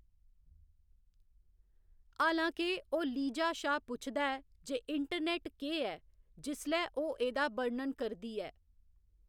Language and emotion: Dogri, neutral